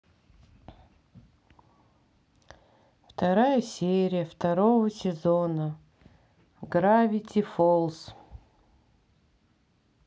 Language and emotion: Russian, sad